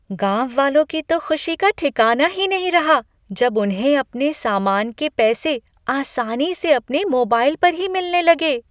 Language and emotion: Hindi, happy